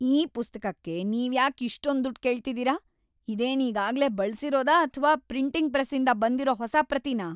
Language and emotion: Kannada, angry